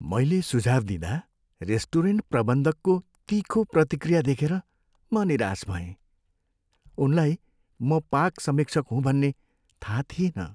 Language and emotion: Nepali, sad